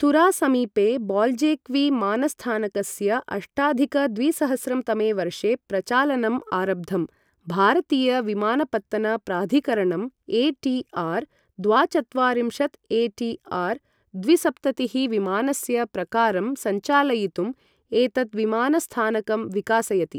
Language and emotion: Sanskrit, neutral